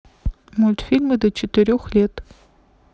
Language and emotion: Russian, neutral